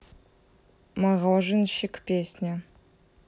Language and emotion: Russian, neutral